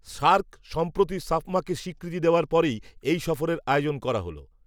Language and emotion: Bengali, neutral